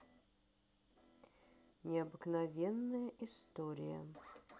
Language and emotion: Russian, neutral